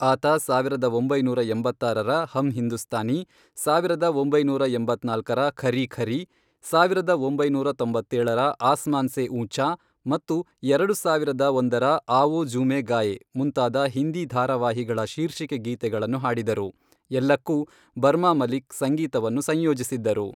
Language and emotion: Kannada, neutral